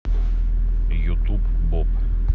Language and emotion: Russian, neutral